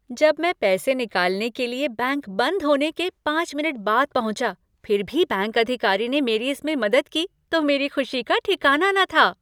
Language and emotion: Hindi, happy